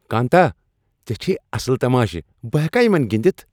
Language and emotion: Kashmiri, happy